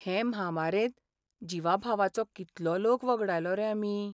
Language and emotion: Goan Konkani, sad